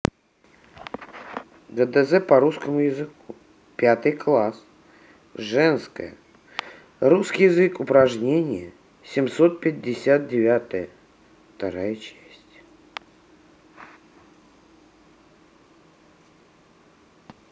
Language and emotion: Russian, neutral